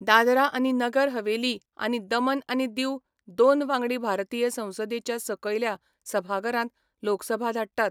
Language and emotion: Goan Konkani, neutral